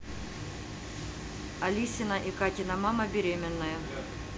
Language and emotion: Russian, neutral